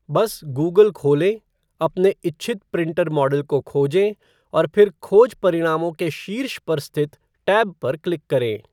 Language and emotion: Hindi, neutral